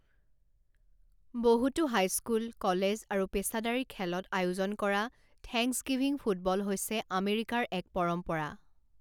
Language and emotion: Assamese, neutral